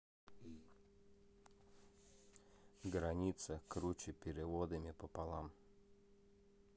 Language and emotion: Russian, neutral